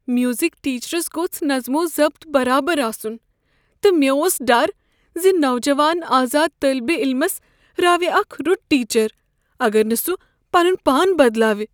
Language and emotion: Kashmiri, fearful